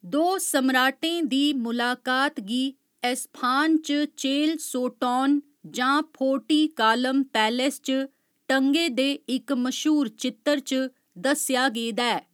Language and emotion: Dogri, neutral